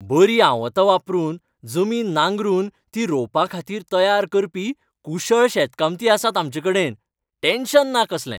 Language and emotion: Goan Konkani, happy